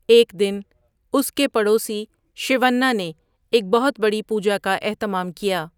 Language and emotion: Urdu, neutral